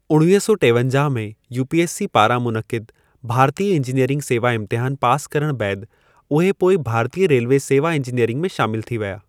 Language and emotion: Sindhi, neutral